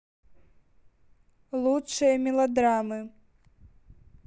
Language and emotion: Russian, neutral